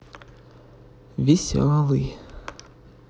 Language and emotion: Russian, neutral